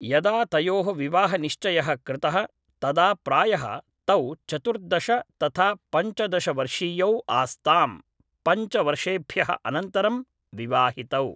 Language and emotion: Sanskrit, neutral